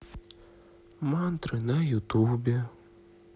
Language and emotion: Russian, sad